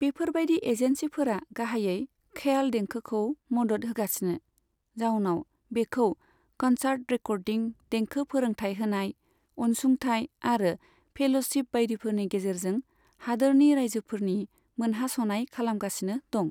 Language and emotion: Bodo, neutral